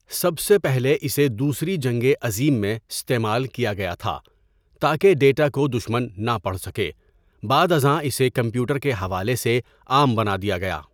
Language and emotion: Urdu, neutral